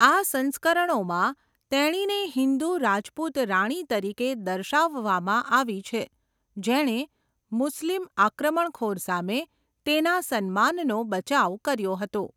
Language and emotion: Gujarati, neutral